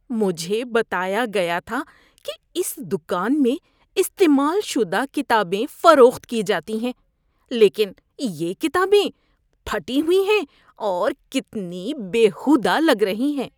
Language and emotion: Urdu, disgusted